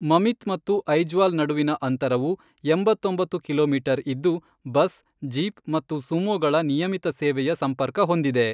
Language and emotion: Kannada, neutral